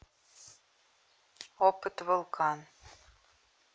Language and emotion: Russian, neutral